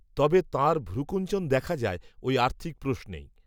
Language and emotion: Bengali, neutral